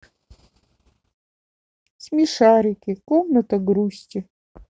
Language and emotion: Russian, sad